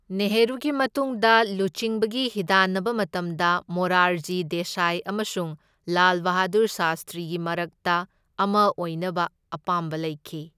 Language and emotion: Manipuri, neutral